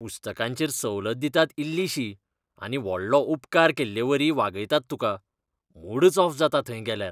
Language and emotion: Goan Konkani, disgusted